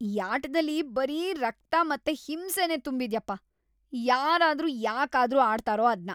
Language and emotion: Kannada, disgusted